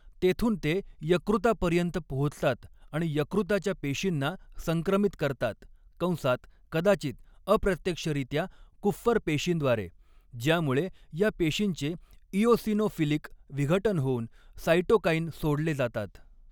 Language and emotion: Marathi, neutral